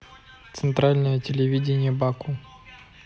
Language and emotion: Russian, neutral